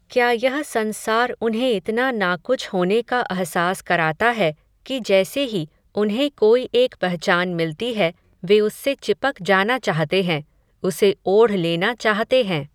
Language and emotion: Hindi, neutral